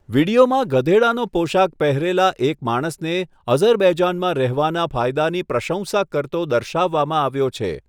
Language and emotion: Gujarati, neutral